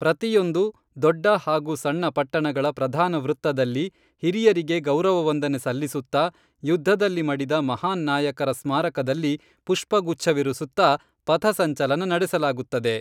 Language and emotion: Kannada, neutral